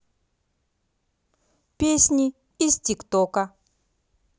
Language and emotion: Russian, neutral